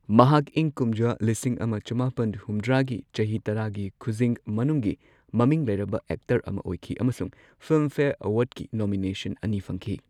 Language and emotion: Manipuri, neutral